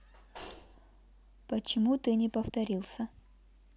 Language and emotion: Russian, neutral